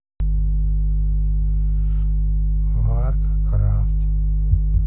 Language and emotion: Russian, neutral